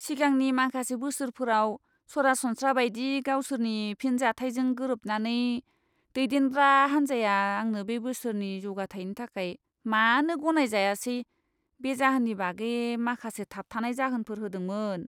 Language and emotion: Bodo, disgusted